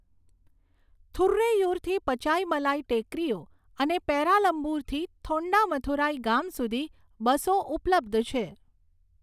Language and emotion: Gujarati, neutral